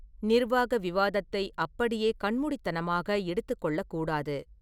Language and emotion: Tamil, neutral